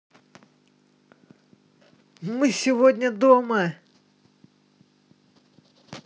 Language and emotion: Russian, positive